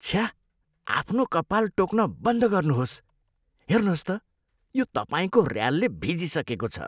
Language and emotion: Nepali, disgusted